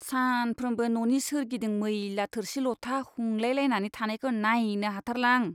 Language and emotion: Bodo, disgusted